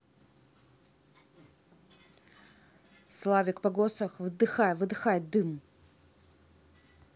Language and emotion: Russian, angry